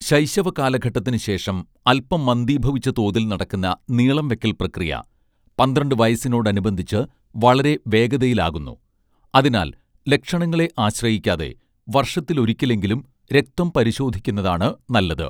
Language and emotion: Malayalam, neutral